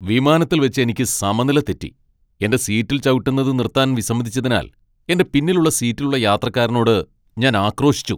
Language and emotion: Malayalam, angry